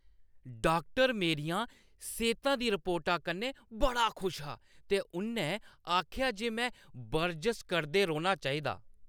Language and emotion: Dogri, happy